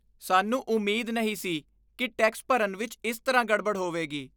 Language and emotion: Punjabi, disgusted